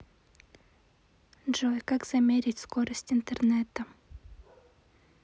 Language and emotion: Russian, neutral